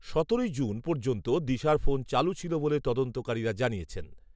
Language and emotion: Bengali, neutral